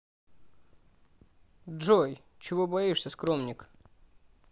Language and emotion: Russian, neutral